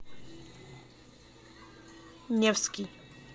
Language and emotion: Russian, neutral